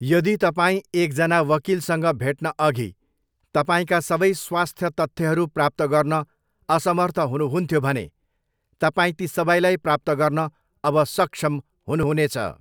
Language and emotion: Nepali, neutral